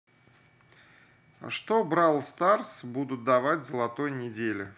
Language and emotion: Russian, neutral